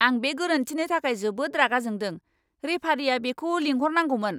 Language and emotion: Bodo, angry